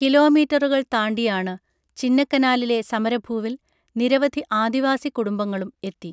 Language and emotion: Malayalam, neutral